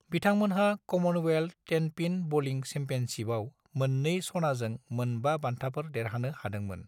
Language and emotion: Bodo, neutral